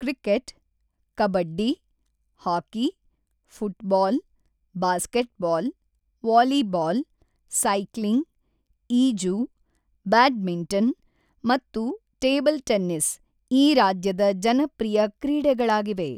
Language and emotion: Kannada, neutral